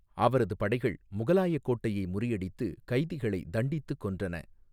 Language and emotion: Tamil, neutral